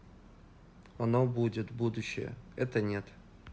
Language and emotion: Russian, neutral